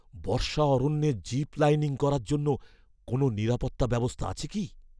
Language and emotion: Bengali, fearful